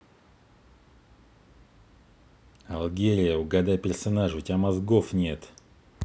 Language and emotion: Russian, angry